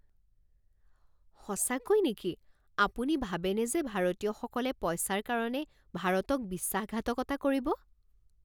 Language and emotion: Assamese, surprised